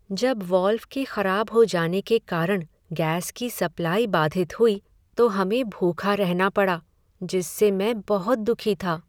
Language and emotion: Hindi, sad